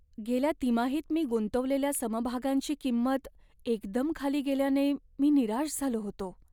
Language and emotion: Marathi, sad